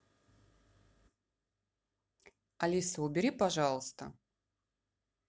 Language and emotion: Russian, neutral